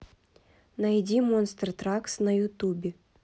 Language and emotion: Russian, neutral